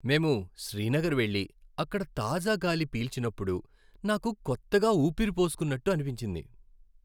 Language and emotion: Telugu, happy